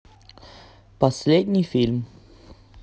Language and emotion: Russian, neutral